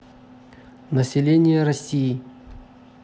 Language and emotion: Russian, neutral